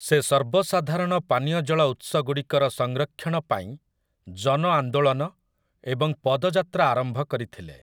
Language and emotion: Odia, neutral